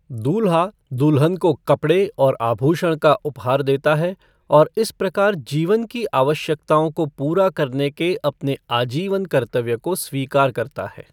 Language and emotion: Hindi, neutral